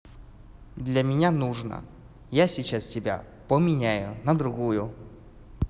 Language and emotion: Russian, neutral